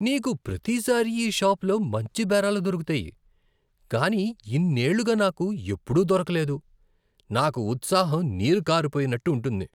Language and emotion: Telugu, disgusted